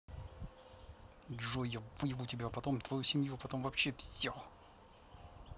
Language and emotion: Russian, angry